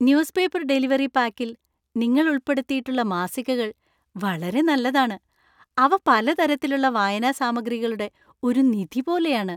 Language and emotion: Malayalam, happy